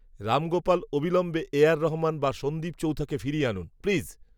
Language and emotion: Bengali, neutral